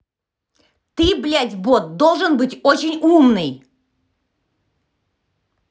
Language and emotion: Russian, angry